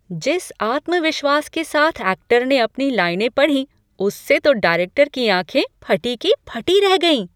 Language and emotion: Hindi, surprised